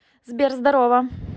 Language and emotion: Russian, positive